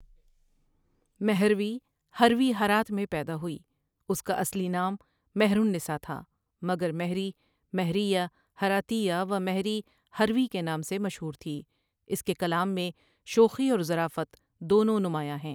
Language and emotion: Urdu, neutral